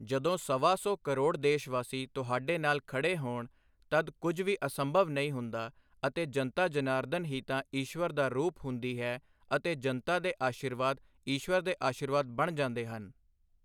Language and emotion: Punjabi, neutral